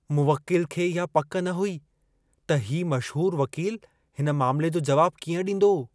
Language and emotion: Sindhi, fearful